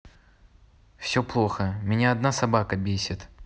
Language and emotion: Russian, neutral